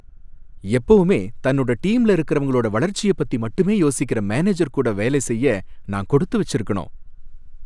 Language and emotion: Tamil, happy